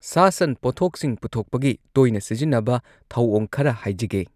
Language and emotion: Manipuri, neutral